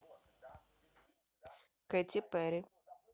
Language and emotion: Russian, neutral